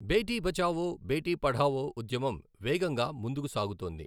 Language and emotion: Telugu, neutral